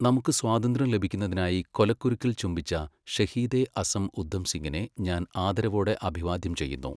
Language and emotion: Malayalam, neutral